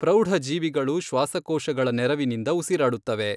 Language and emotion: Kannada, neutral